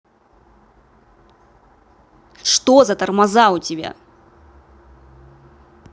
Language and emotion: Russian, angry